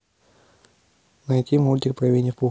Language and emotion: Russian, neutral